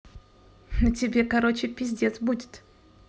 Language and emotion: Russian, neutral